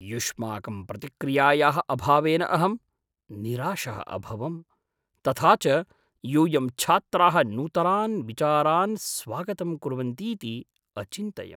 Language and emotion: Sanskrit, surprised